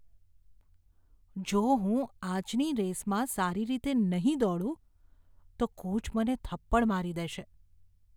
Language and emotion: Gujarati, fearful